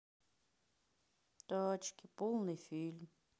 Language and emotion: Russian, sad